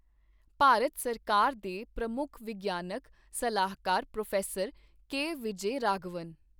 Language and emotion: Punjabi, neutral